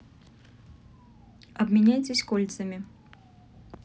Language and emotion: Russian, neutral